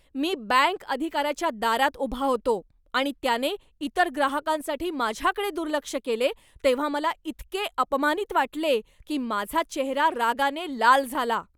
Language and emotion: Marathi, angry